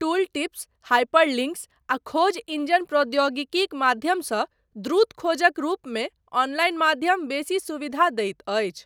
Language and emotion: Maithili, neutral